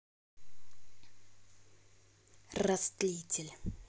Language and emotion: Russian, angry